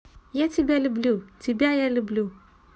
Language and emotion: Russian, positive